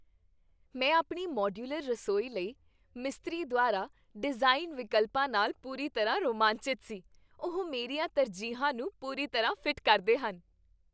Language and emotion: Punjabi, happy